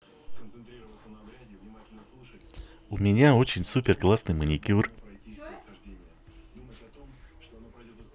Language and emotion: Russian, positive